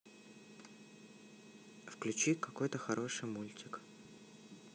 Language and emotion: Russian, neutral